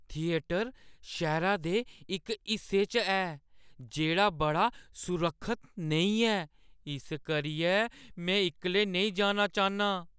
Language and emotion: Dogri, fearful